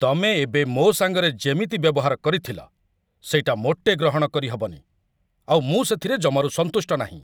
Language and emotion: Odia, angry